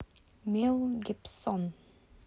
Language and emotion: Russian, neutral